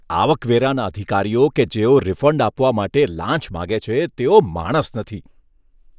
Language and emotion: Gujarati, disgusted